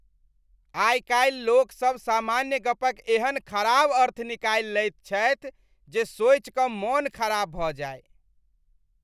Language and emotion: Maithili, disgusted